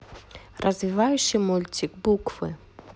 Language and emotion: Russian, neutral